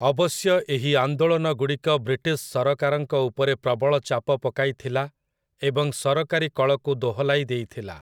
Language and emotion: Odia, neutral